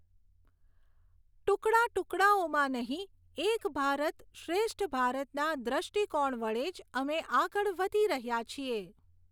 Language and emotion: Gujarati, neutral